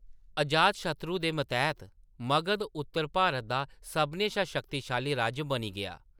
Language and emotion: Dogri, neutral